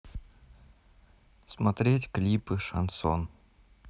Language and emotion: Russian, neutral